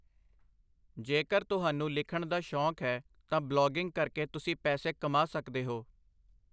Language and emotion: Punjabi, neutral